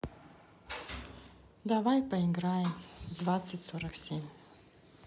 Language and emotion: Russian, sad